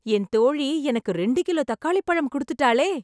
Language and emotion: Tamil, happy